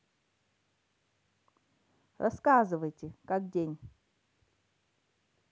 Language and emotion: Russian, neutral